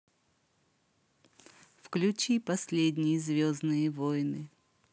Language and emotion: Russian, positive